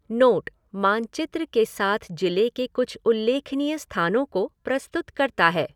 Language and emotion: Hindi, neutral